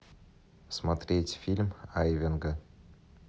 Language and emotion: Russian, neutral